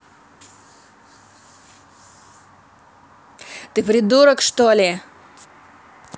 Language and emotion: Russian, angry